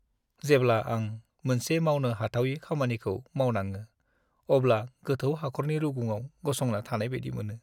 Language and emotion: Bodo, sad